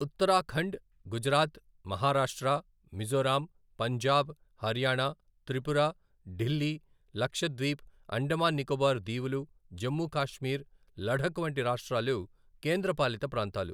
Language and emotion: Telugu, neutral